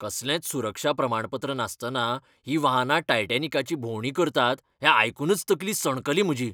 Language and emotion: Goan Konkani, angry